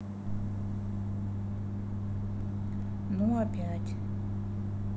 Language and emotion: Russian, sad